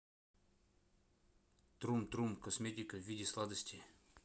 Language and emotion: Russian, neutral